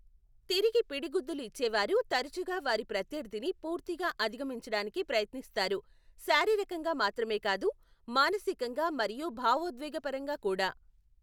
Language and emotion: Telugu, neutral